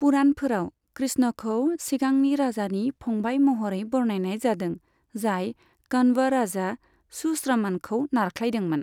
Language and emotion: Bodo, neutral